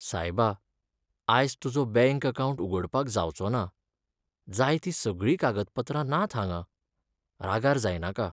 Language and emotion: Goan Konkani, sad